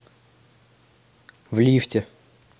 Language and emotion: Russian, neutral